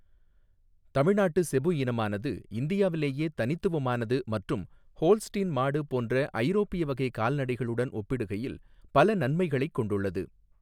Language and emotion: Tamil, neutral